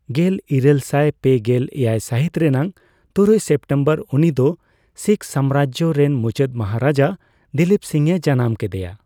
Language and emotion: Santali, neutral